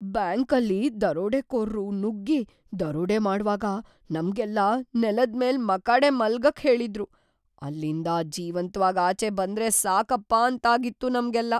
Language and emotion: Kannada, fearful